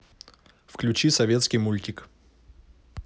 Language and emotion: Russian, neutral